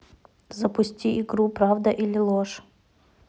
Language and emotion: Russian, neutral